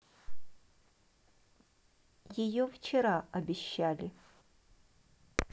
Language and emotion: Russian, neutral